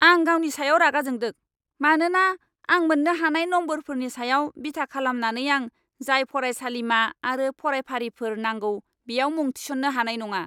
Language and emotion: Bodo, angry